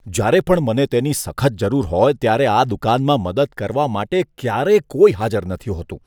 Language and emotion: Gujarati, disgusted